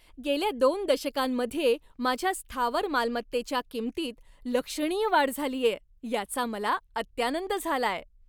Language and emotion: Marathi, happy